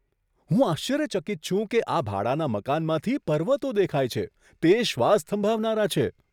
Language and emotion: Gujarati, surprised